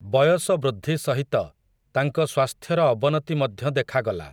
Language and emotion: Odia, neutral